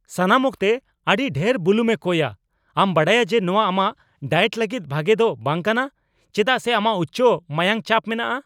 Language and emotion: Santali, angry